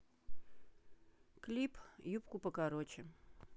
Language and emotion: Russian, neutral